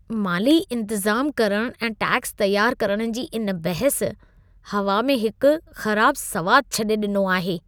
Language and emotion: Sindhi, disgusted